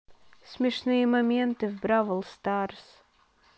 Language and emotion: Russian, sad